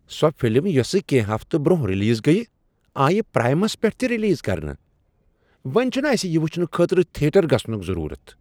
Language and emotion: Kashmiri, surprised